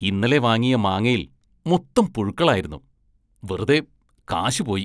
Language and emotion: Malayalam, disgusted